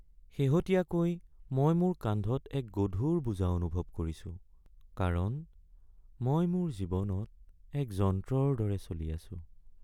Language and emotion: Assamese, sad